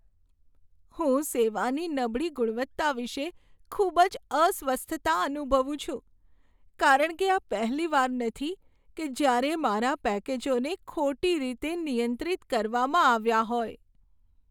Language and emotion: Gujarati, sad